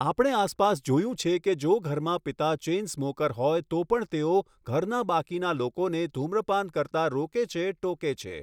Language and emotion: Gujarati, neutral